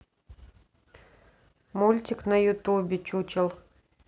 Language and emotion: Russian, neutral